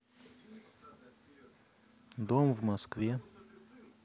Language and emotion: Russian, neutral